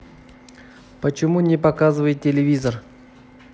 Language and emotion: Russian, neutral